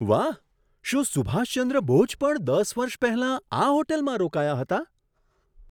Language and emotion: Gujarati, surprised